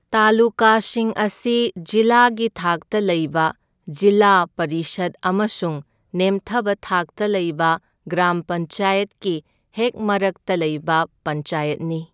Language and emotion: Manipuri, neutral